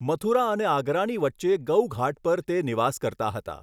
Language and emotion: Gujarati, neutral